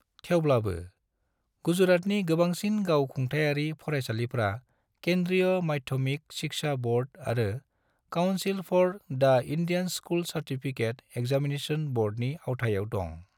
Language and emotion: Bodo, neutral